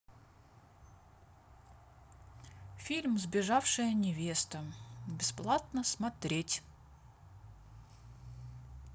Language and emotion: Russian, neutral